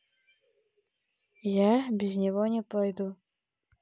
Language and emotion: Russian, neutral